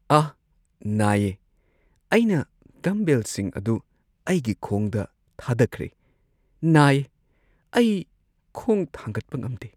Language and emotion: Manipuri, sad